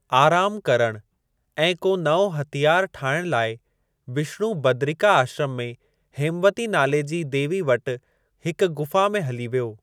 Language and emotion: Sindhi, neutral